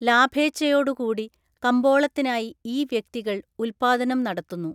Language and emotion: Malayalam, neutral